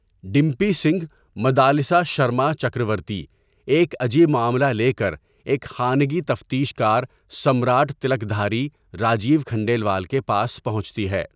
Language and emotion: Urdu, neutral